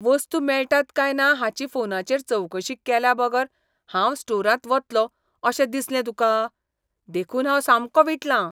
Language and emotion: Goan Konkani, disgusted